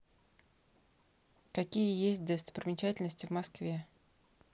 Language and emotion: Russian, neutral